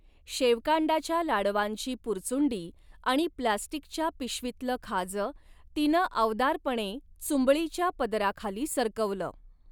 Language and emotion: Marathi, neutral